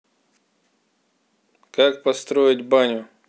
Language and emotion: Russian, neutral